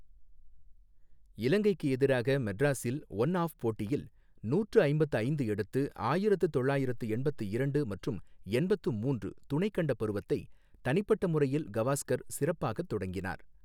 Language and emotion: Tamil, neutral